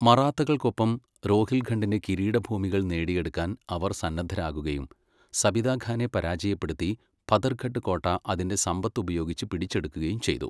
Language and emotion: Malayalam, neutral